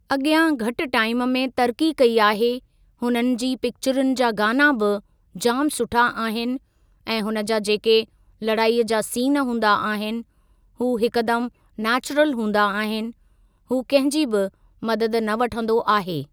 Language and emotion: Sindhi, neutral